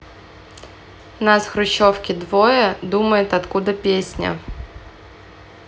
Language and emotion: Russian, neutral